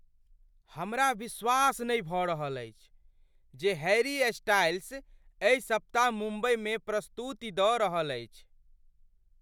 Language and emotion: Maithili, surprised